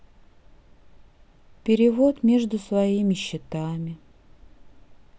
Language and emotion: Russian, sad